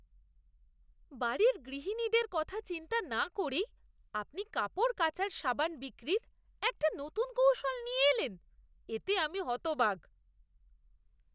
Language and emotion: Bengali, disgusted